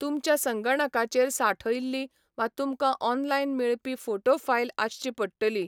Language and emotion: Goan Konkani, neutral